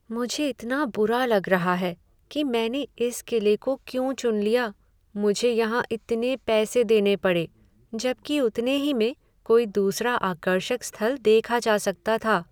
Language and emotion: Hindi, sad